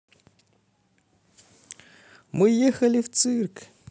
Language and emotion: Russian, positive